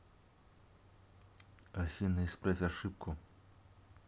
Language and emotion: Russian, neutral